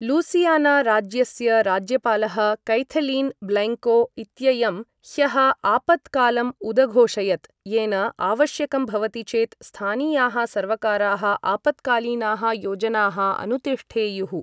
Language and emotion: Sanskrit, neutral